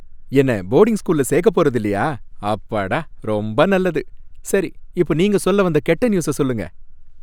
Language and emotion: Tamil, happy